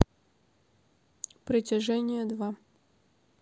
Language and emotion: Russian, neutral